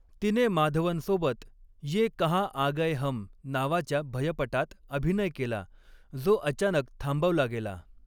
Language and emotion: Marathi, neutral